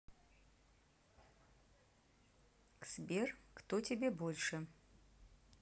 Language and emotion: Russian, neutral